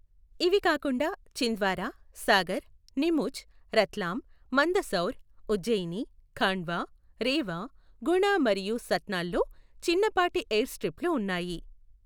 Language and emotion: Telugu, neutral